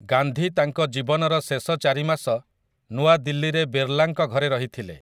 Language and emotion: Odia, neutral